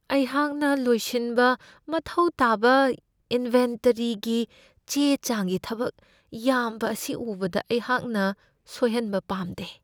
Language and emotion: Manipuri, fearful